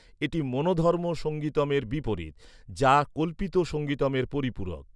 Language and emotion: Bengali, neutral